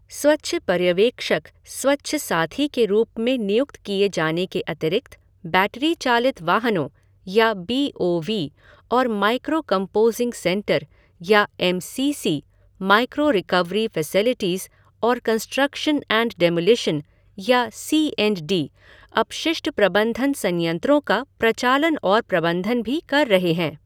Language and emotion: Hindi, neutral